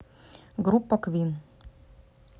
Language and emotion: Russian, neutral